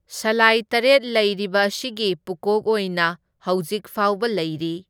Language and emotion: Manipuri, neutral